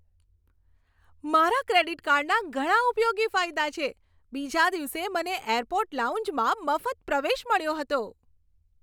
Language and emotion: Gujarati, happy